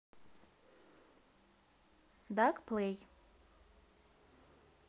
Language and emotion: Russian, neutral